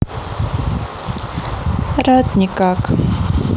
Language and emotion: Russian, sad